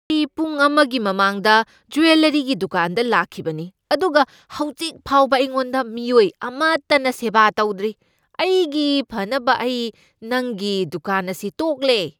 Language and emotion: Manipuri, angry